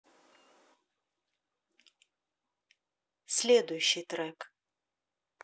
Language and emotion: Russian, neutral